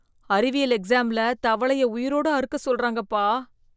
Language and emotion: Tamil, disgusted